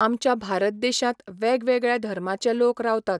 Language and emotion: Goan Konkani, neutral